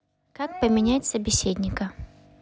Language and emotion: Russian, neutral